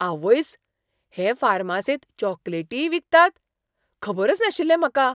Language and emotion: Goan Konkani, surprised